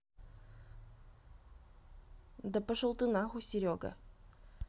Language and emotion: Russian, neutral